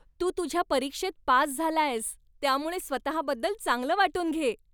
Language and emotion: Marathi, happy